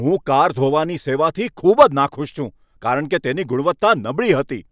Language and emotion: Gujarati, angry